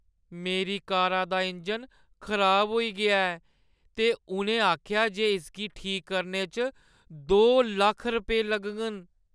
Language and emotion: Dogri, sad